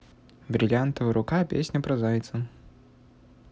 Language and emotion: Russian, neutral